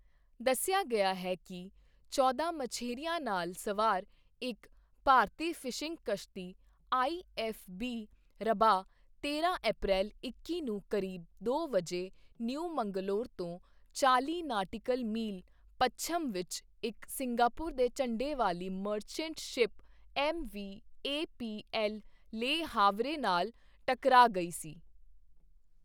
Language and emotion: Punjabi, neutral